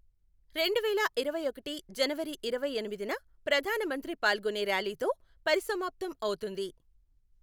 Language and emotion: Telugu, neutral